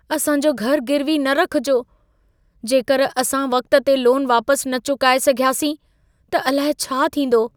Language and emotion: Sindhi, fearful